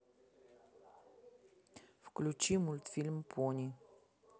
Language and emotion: Russian, neutral